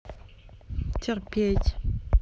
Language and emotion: Russian, neutral